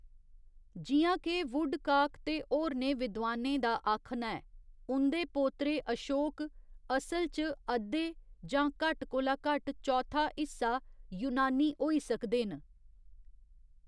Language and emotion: Dogri, neutral